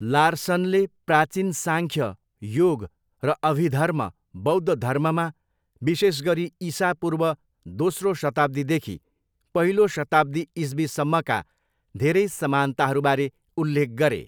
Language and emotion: Nepali, neutral